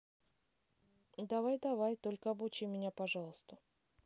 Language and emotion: Russian, neutral